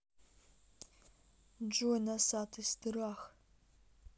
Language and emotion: Russian, neutral